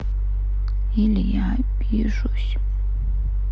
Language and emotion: Russian, sad